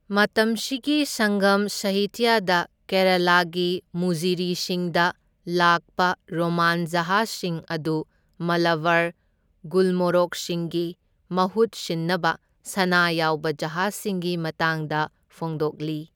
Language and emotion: Manipuri, neutral